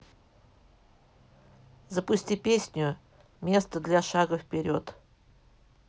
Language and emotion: Russian, neutral